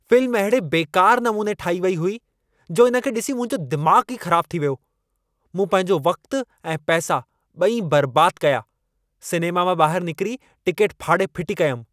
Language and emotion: Sindhi, angry